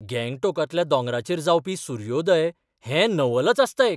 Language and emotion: Goan Konkani, surprised